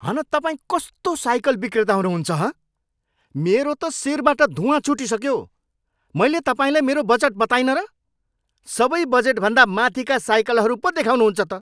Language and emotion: Nepali, angry